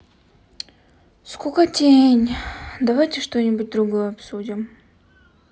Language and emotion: Russian, sad